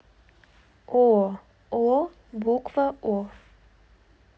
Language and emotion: Russian, neutral